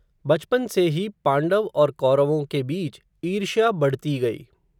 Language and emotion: Hindi, neutral